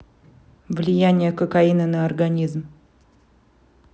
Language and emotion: Russian, neutral